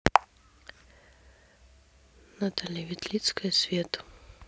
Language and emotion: Russian, sad